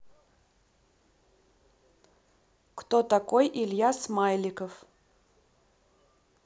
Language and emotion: Russian, neutral